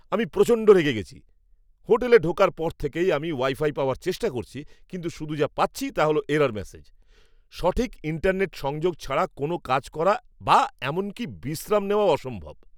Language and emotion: Bengali, angry